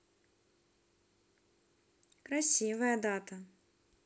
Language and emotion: Russian, positive